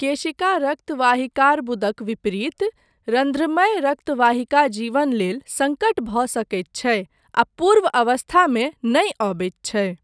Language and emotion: Maithili, neutral